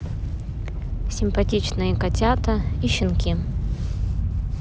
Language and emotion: Russian, neutral